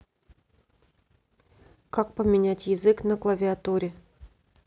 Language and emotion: Russian, neutral